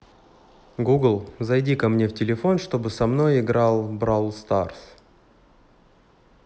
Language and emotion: Russian, neutral